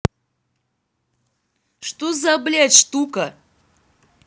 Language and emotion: Russian, angry